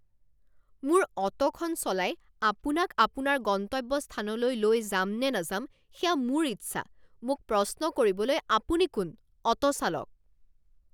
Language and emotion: Assamese, angry